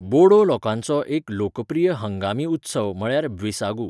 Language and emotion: Goan Konkani, neutral